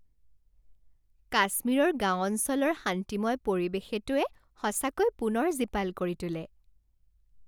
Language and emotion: Assamese, happy